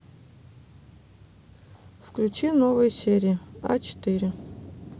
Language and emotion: Russian, neutral